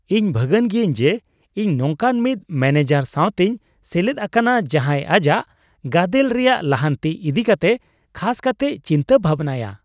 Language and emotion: Santali, happy